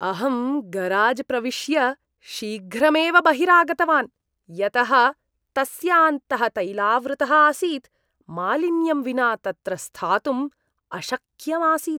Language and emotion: Sanskrit, disgusted